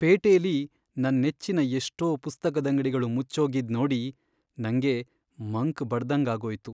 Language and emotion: Kannada, sad